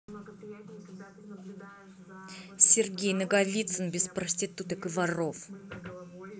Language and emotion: Russian, angry